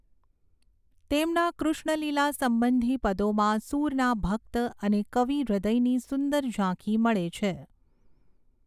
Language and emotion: Gujarati, neutral